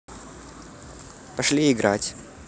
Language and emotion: Russian, positive